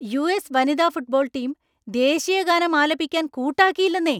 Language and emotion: Malayalam, angry